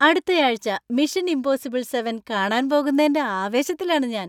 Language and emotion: Malayalam, happy